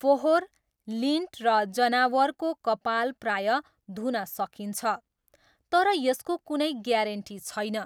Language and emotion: Nepali, neutral